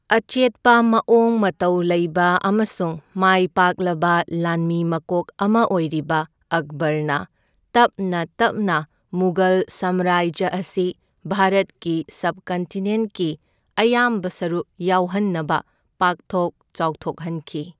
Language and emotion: Manipuri, neutral